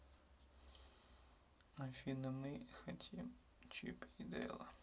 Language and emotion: Russian, sad